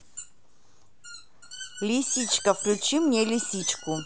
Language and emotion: Russian, positive